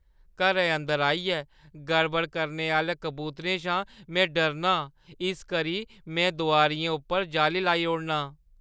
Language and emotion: Dogri, fearful